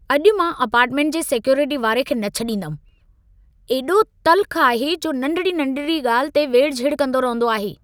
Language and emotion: Sindhi, angry